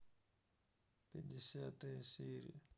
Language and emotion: Russian, sad